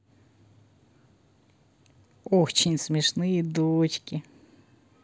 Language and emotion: Russian, positive